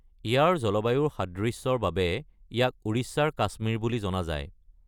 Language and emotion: Assamese, neutral